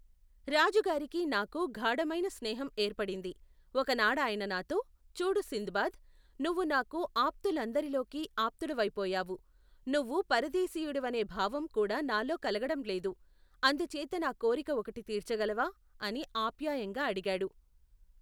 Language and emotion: Telugu, neutral